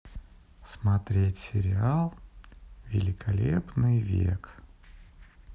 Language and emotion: Russian, neutral